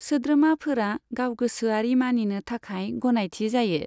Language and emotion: Bodo, neutral